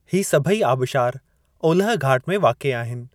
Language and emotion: Sindhi, neutral